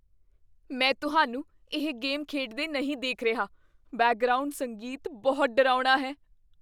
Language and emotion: Punjabi, fearful